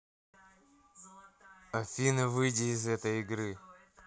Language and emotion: Russian, angry